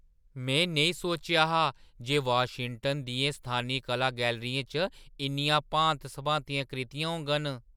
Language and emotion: Dogri, surprised